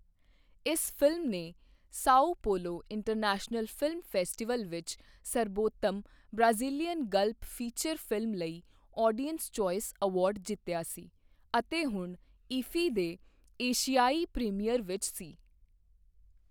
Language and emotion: Punjabi, neutral